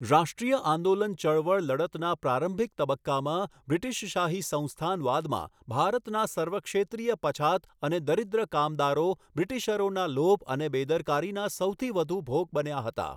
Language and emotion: Gujarati, neutral